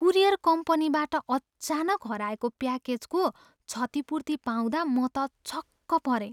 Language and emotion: Nepali, surprised